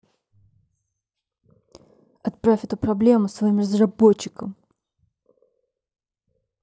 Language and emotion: Russian, angry